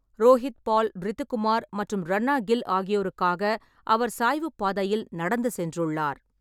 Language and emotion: Tamil, neutral